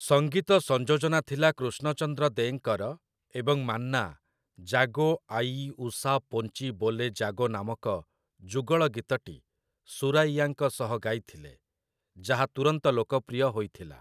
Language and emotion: Odia, neutral